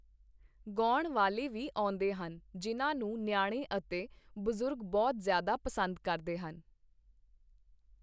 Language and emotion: Punjabi, neutral